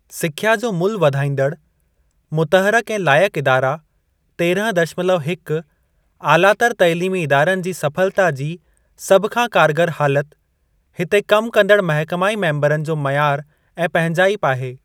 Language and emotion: Sindhi, neutral